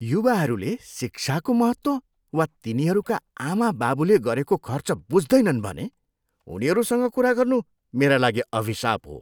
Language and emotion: Nepali, disgusted